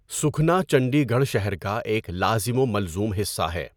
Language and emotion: Urdu, neutral